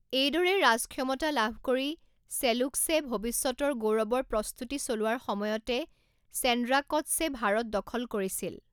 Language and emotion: Assamese, neutral